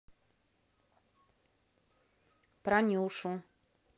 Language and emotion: Russian, neutral